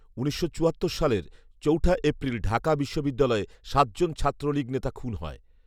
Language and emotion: Bengali, neutral